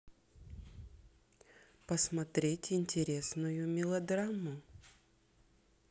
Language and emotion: Russian, neutral